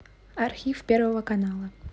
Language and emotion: Russian, neutral